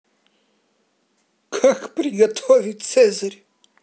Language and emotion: Russian, positive